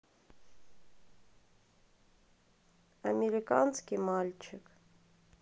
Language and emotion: Russian, sad